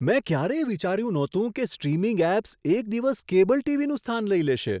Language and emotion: Gujarati, surprised